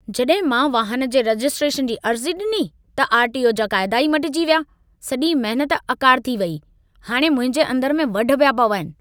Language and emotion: Sindhi, angry